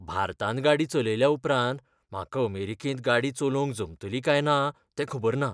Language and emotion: Goan Konkani, fearful